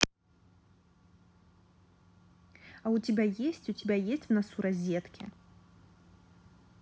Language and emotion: Russian, neutral